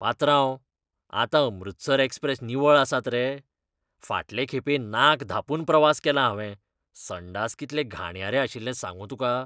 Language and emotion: Goan Konkani, disgusted